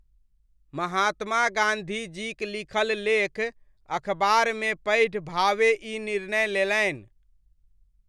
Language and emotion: Maithili, neutral